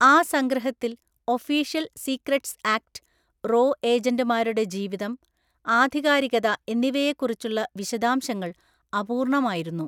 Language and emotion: Malayalam, neutral